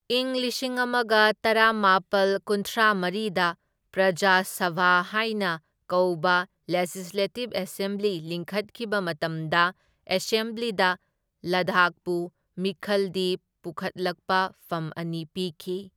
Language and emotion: Manipuri, neutral